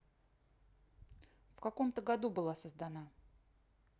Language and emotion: Russian, neutral